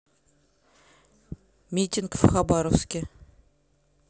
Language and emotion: Russian, neutral